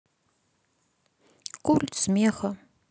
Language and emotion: Russian, sad